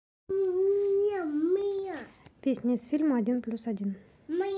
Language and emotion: Russian, neutral